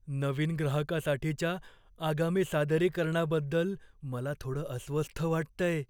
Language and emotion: Marathi, fearful